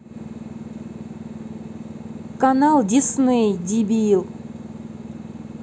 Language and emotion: Russian, angry